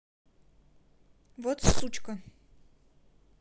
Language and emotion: Russian, angry